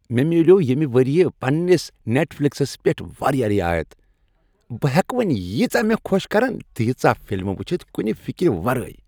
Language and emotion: Kashmiri, happy